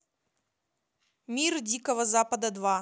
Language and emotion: Russian, positive